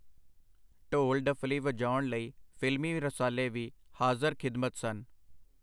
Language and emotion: Punjabi, neutral